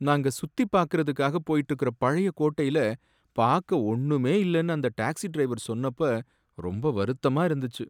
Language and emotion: Tamil, sad